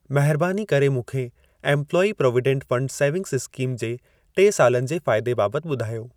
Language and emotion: Sindhi, neutral